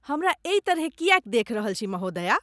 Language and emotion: Maithili, disgusted